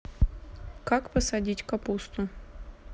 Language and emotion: Russian, neutral